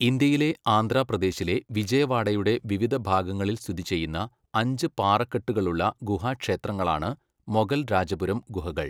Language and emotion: Malayalam, neutral